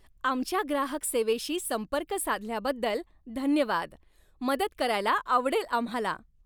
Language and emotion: Marathi, happy